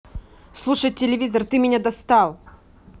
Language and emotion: Russian, angry